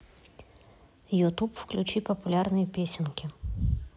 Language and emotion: Russian, neutral